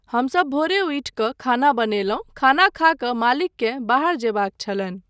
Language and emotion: Maithili, neutral